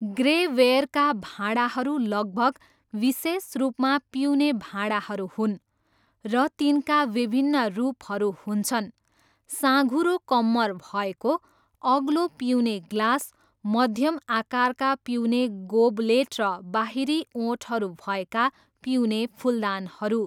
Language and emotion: Nepali, neutral